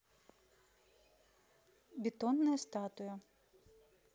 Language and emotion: Russian, neutral